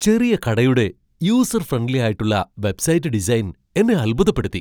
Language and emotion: Malayalam, surprised